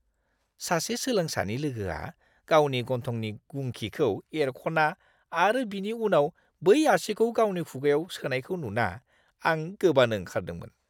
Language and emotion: Bodo, disgusted